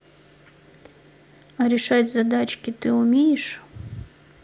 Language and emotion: Russian, neutral